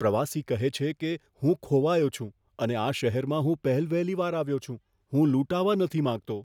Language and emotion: Gujarati, fearful